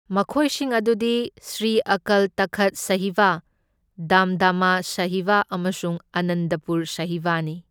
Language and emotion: Manipuri, neutral